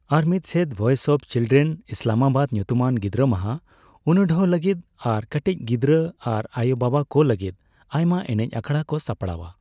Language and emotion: Santali, neutral